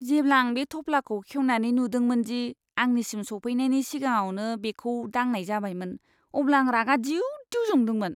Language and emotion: Bodo, disgusted